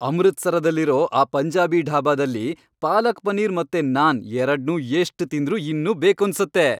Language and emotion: Kannada, happy